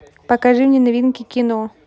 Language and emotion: Russian, neutral